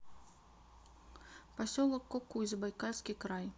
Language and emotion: Russian, neutral